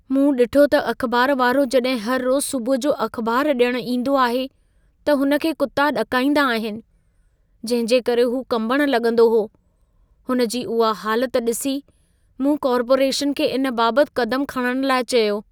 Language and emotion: Sindhi, fearful